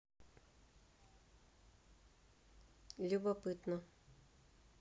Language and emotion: Russian, neutral